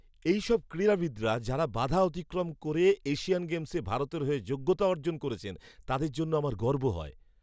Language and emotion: Bengali, happy